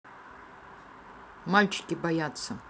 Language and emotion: Russian, neutral